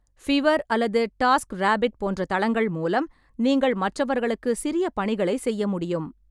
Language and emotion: Tamil, neutral